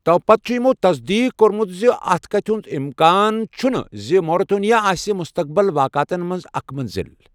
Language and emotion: Kashmiri, neutral